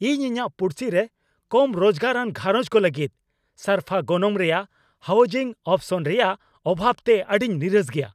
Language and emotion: Santali, angry